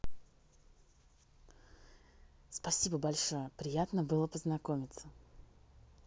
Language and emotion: Russian, positive